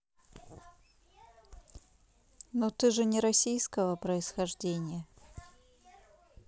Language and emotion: Russian, neutral